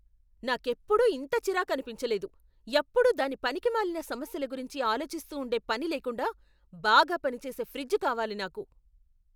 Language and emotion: Telugu, angry